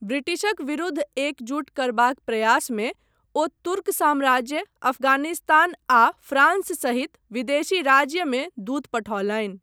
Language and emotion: Maithili, neutral